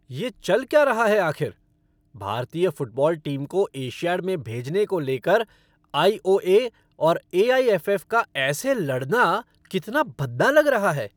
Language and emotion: Hindi, angry